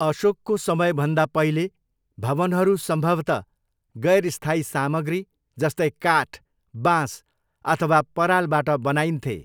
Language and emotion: Nepali, neutral